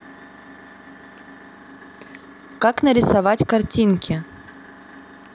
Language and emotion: Russian, neutral